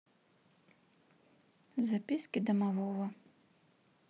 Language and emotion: Russian, sad